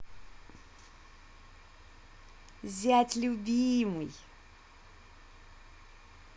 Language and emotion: Russian, positive